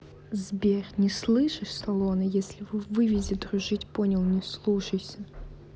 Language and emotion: Russian, neutral